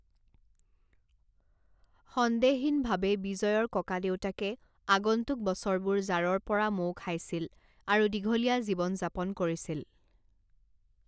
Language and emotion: Assamese, neutral